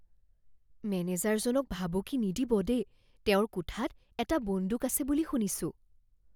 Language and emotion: Assamese, fearful